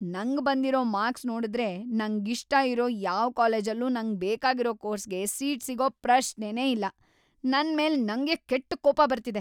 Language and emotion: Kannada, angry